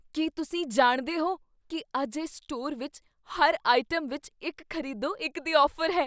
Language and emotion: Punjabi, surprised